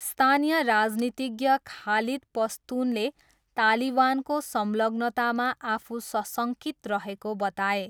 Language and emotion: Nepali, neutral